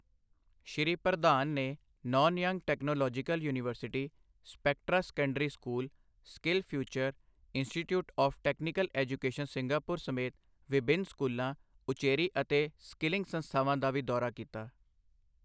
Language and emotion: Punjabi, neutral